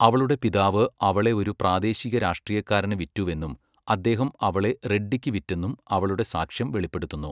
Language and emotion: Malayalam, neutral